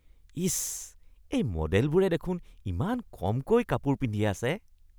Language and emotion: Assamese, disgusted